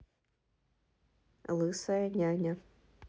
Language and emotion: Russian, neutral